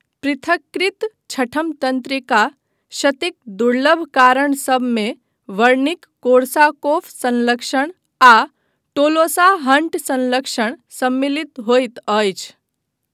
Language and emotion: Maithili, neutral